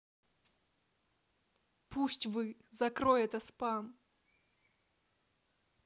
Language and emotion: Russian, angry